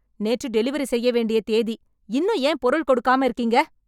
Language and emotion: Tamil, angry